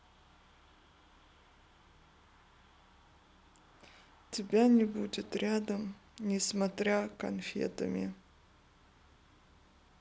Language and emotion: Russian, sad